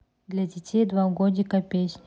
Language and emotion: Russian, neutral